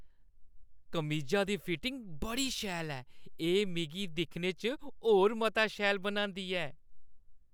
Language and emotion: Dogri, happy